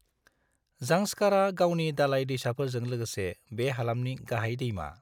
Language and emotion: Bodo, neutral